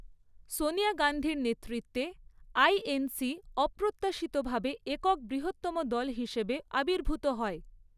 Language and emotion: Bengali, neutral